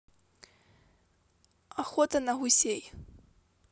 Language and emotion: Russian, neutral